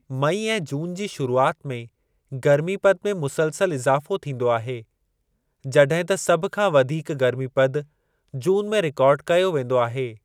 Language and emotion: Sindhi, neutral